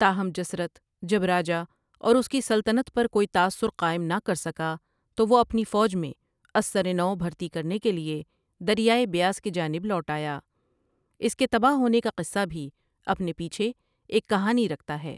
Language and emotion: Urdu, neutral